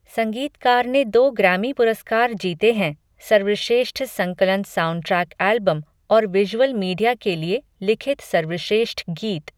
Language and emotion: Hindi, neutral